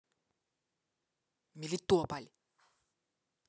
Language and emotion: Russian, angry